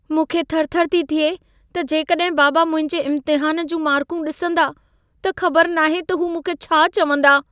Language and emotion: Sindhi, fearful